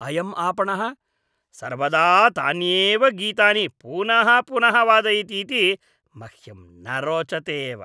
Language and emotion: Sanskrit, disgusted